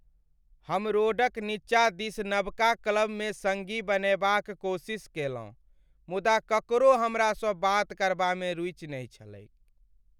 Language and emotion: Maithili, sad